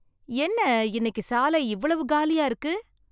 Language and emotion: Tamil, surprised